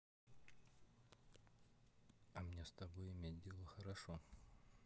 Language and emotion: Russian, neutral